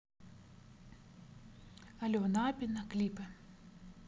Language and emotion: Russian, neutral